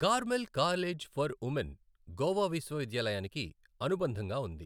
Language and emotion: Telugu, neutral